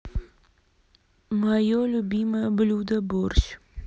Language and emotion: Russian, neutral